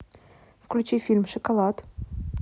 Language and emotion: Russian, neutral